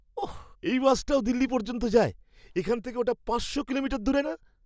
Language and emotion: Bengali, surprised